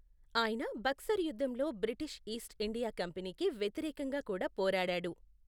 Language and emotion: Telugu, neutral